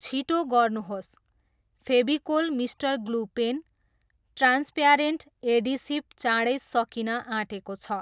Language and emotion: Nepali, neutral